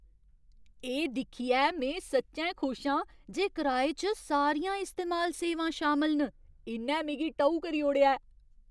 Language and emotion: Dogri, surprised